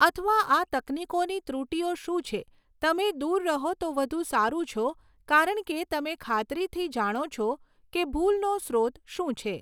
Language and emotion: Gujarati, neutral